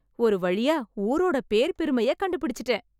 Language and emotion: Tamil, happy